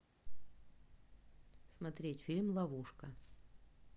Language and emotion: Russian, neutral